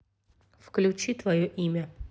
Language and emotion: Russian, neutral